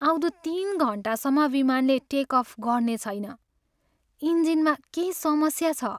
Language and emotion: Nepali, sad